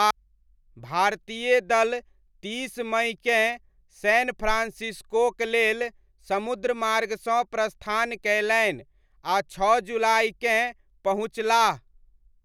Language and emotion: Maithili, neutral